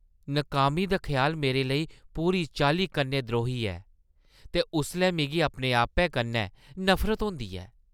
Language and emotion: Dogri, disgusted